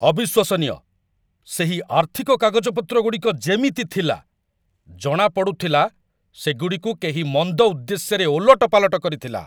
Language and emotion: Odia, angry